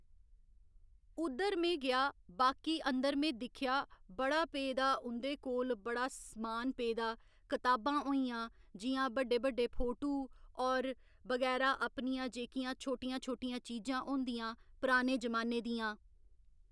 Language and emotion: Dogri, neutral